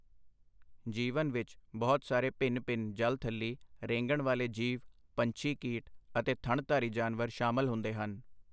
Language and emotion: Punjabi, neutral